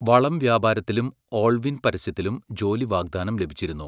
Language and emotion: Malayalam, neutral